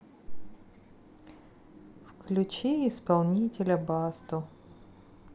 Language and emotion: Russian, neutral